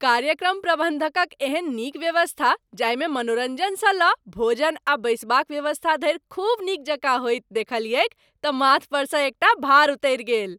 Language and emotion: Maithili, happy